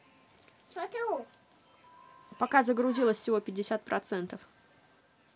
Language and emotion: Russian, neutral